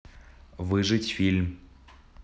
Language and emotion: Russian, neutral